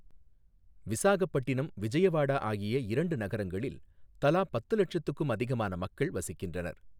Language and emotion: Tamil, neutral